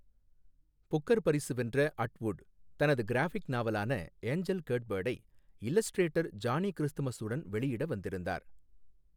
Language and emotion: Tamil, neutral